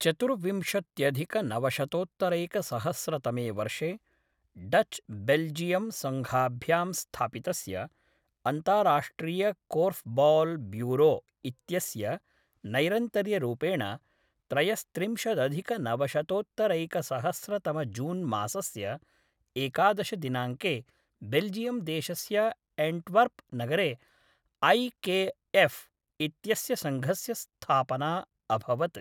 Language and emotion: Sanskrit, neutral